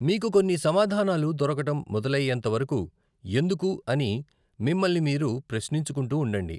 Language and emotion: Telugu, neutral